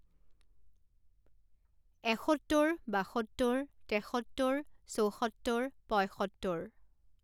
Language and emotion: Assamese, neutral